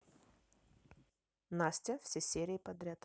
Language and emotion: Russian, neutral